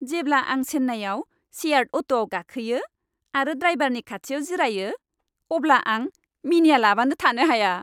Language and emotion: Bodo, happy